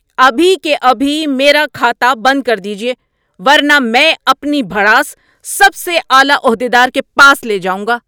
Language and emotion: Urdu, angry